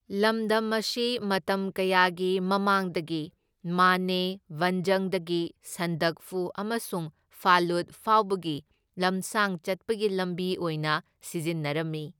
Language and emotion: Manipuri, neutral